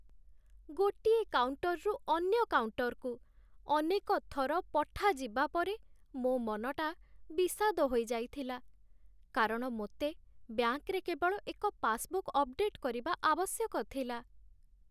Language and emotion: Odia, sad